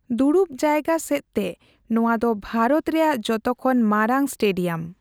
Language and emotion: Santali, neutral